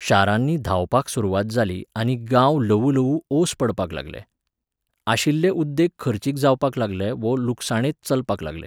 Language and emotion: Goan Konkani, neutral